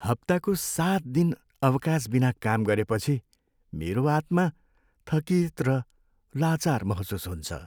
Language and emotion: Nepali, sad